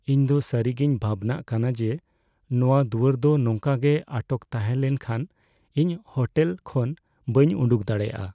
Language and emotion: Santali, fearful